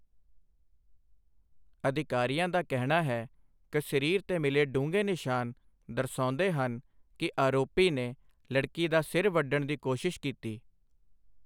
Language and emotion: Punjabi, neutral